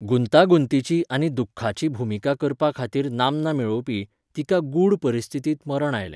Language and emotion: Goan Konkani, neutral